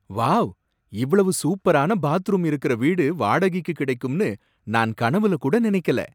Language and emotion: Tamil, surprised